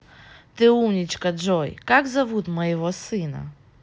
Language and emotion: Russian, positive